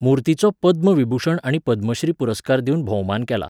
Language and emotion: Goan Konkani, neutral